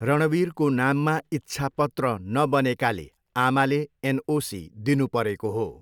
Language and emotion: Nepali, neutral